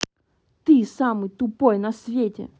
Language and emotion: Russian, angry